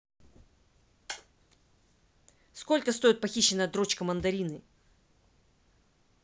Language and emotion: Russian, angry